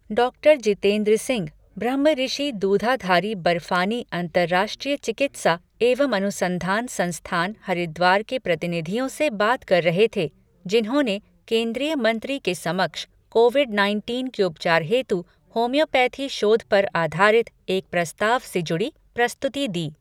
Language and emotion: Hindi, neutral